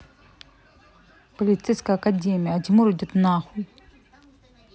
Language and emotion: Russian, angry